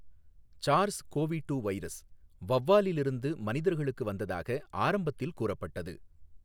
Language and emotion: Tamil, neutral